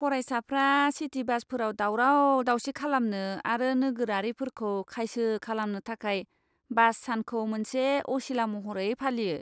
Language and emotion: Bodo, disgusted